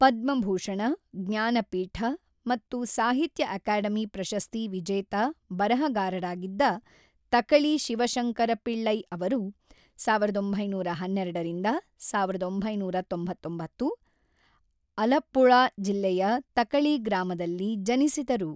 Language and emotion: Kannada, neutral